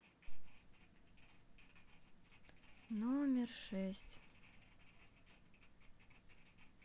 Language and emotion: Russian, sad